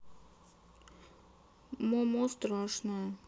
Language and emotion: Russian, sad